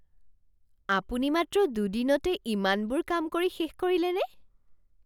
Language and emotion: Assamese, surprised